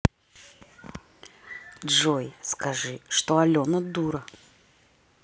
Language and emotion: Russian, neutral